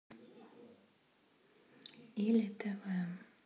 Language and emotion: Russian, sad